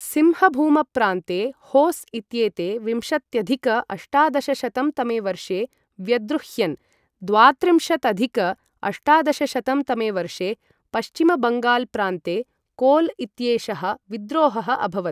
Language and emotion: Sanskrit, neutral